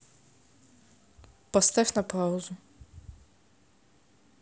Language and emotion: Russian, neutral